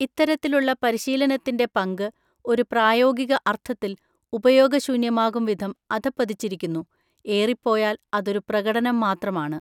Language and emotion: Malayalam, neutral